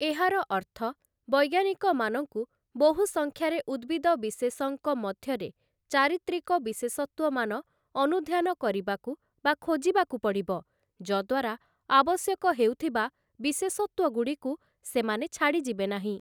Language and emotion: Odia, neutral